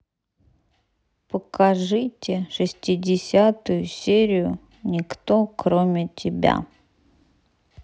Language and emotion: Russian, neutral